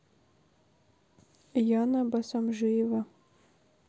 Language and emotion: Russian, neutral